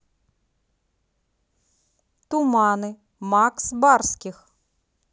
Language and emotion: Russian, neutral